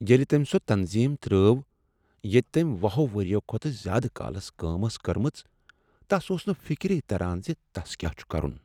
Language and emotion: Kashmiri, sad